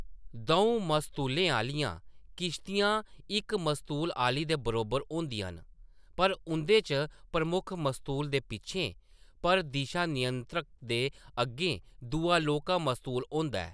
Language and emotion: Dogri, neutral